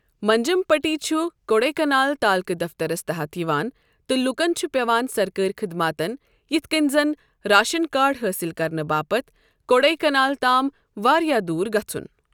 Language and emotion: Kashmiri, neutral